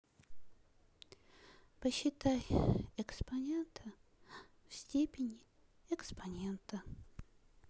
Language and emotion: Russian, sad